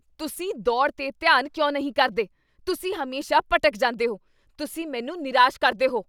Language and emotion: Punjabi, angry